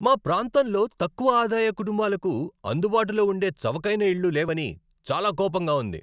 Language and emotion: Telugu, angry